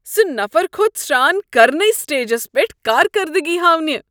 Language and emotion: Kashmiri, disgusted